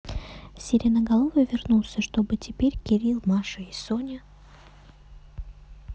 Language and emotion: Russian, neutral